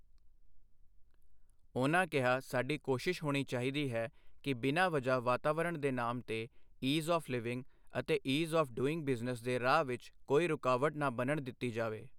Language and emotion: Punjabi, neutral